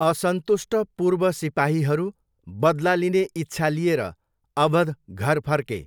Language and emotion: Nepali, neutral